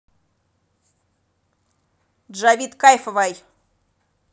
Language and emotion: Russian, neutral